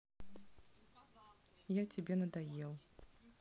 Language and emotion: Russian, sad